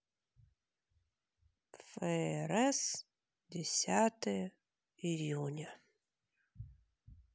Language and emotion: Russian, sad